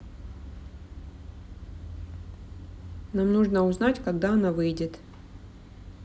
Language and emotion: Russian, neutral